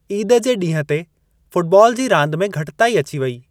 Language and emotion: Sindhi, neutral